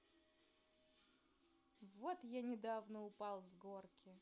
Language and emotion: Russian, neutral